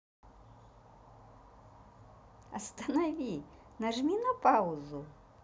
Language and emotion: Russian, positive